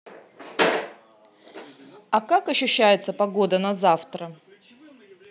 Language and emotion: Russian, neutral